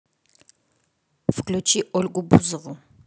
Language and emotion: Russian, neutral